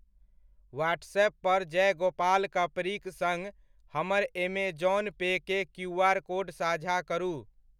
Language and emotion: Maithili, neutral